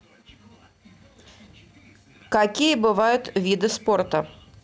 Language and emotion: Russian, neutral